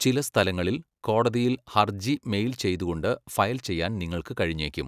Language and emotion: Malayalam, neutral